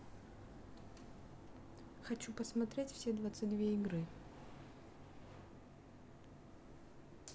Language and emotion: Russian, neutral